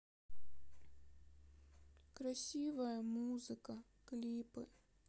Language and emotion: Russian, sad